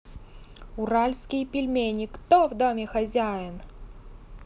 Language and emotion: Russian, neutral